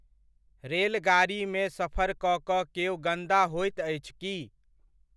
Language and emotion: Maithili, neutral